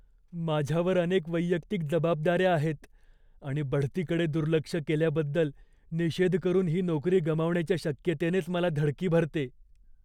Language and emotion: Marathi, fearful